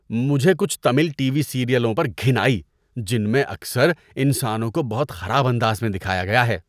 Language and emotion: Urdu, disgusted